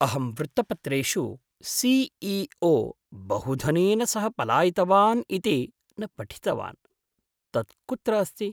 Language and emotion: Sanskrit, surprised